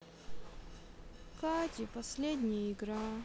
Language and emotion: Russian, sad